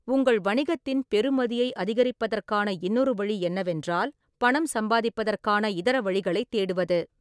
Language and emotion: Tamil, neutral